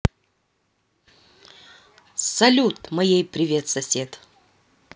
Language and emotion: Russian, positive